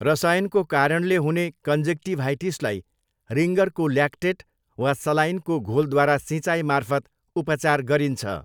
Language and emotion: Nepali, neutral